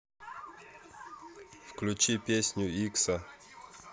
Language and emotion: Russian, neutral